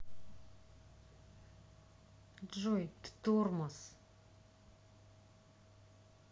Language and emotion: Russian, angry